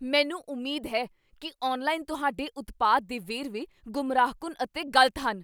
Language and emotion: Punjabi, angry